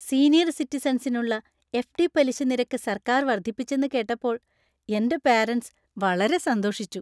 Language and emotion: Malayalam, happy